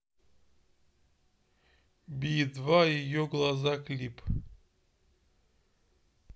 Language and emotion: Russian, neutral